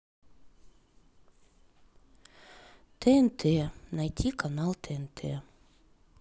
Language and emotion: Russian, sad